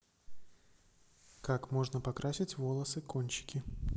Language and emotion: Russian, neutral